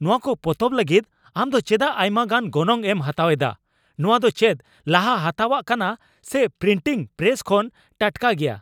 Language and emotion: Santali, angry